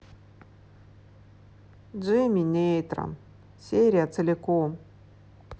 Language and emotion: Russian, sad